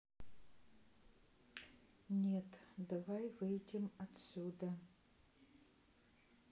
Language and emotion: Russian, neutral